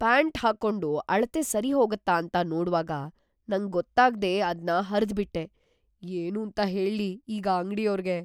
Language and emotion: Kannada, fearful